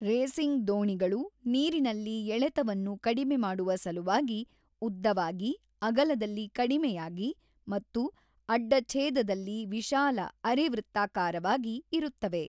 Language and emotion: Kannada, neutral